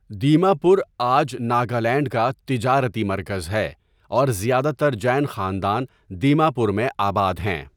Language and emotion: Urdu, neutral